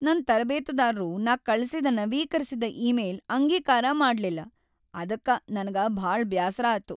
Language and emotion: Kannada, sad